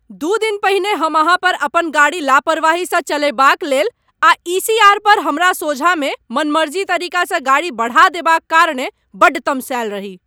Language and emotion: Maithili, angry